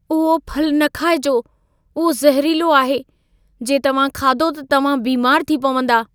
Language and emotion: Sindhi, fearful